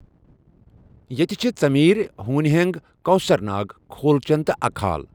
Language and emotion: Kashmiri, neutral